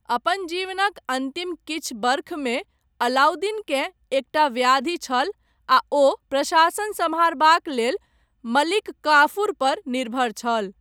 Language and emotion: Maithili, neutral